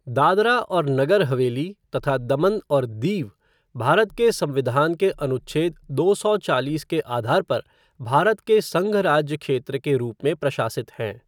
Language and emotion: Hindi, neutral